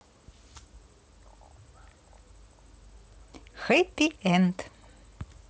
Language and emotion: Russian, positive